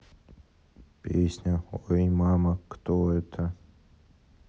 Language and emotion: Russian, sad